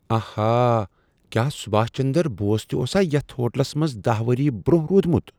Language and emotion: Kashmiri, surprised